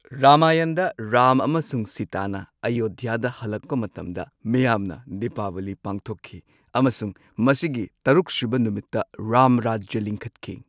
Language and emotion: Manipuri, neutral